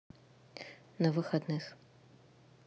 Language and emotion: Russian, neutral